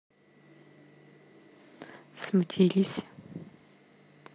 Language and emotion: Russian, neutral